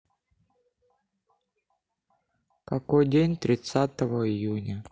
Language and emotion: Russian, sad